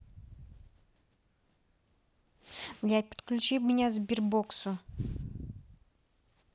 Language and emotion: Russian, neutral